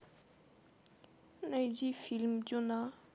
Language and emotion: Russian, sad